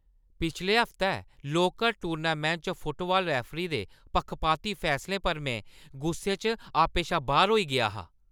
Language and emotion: Dogri, angry